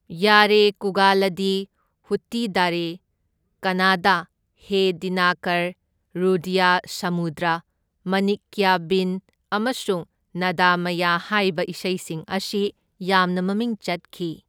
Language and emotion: Manipuri, neutral